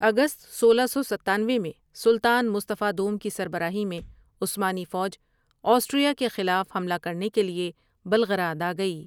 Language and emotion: Urdu, neutral